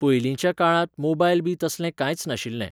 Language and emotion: Goan Konkani, neutral